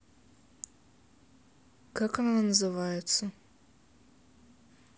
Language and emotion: Russian, neutral